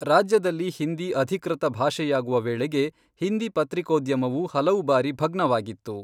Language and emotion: Kannada, neutral